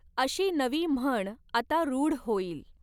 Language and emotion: Marathi, neutral